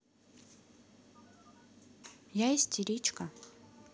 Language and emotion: Russian, neutral